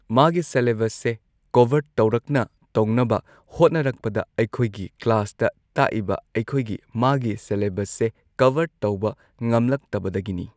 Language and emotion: Manipuri, neutral